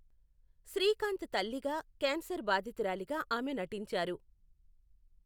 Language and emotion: Telugu, neutral